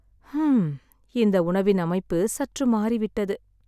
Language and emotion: Tamil, sad